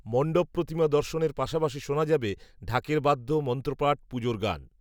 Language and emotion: Bengali, neutral